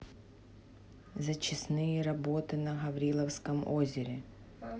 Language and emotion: Russian, neutral